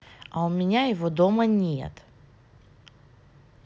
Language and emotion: Russian, neutral